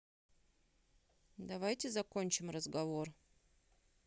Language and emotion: Russian, neutral